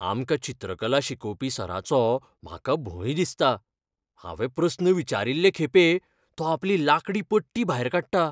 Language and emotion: Goan Konkani, fearful